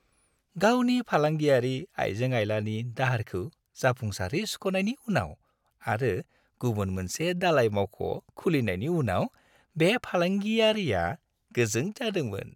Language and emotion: Bodo, happy